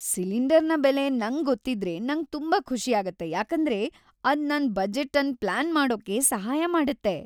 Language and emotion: Kannada, happy